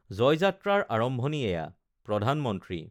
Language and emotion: Assamese, neutral